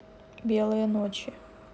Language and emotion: Russian, neutral